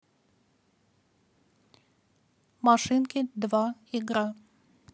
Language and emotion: Russian, neutral